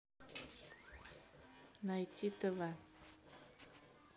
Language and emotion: Russian, neutral